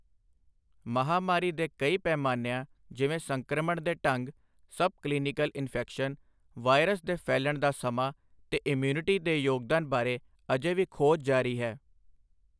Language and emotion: Punjabi, neutral